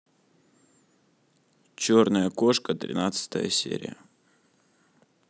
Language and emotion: Russian, neutral